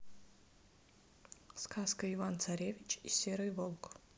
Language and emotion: Russian, neutral